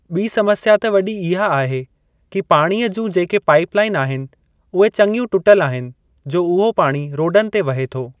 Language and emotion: Sindhi, neutral